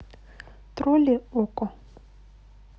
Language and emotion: Russian, neutral